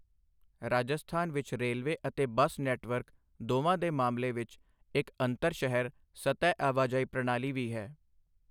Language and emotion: Punjabi, neutral